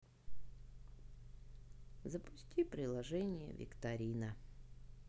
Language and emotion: Russian, sad